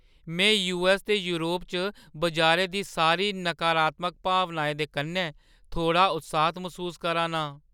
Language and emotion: Dogri, fearful